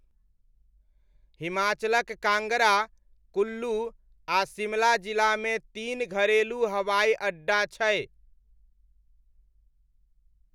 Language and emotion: Maithili, neutral